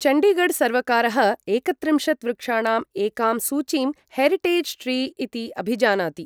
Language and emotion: Sanskrit, neutral